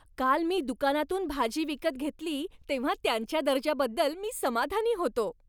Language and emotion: Marathi, happy